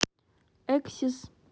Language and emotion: Russian, neutral